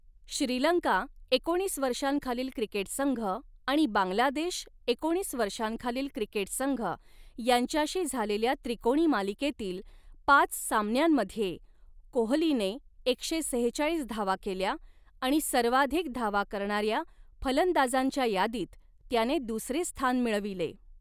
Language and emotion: Marathi, neutral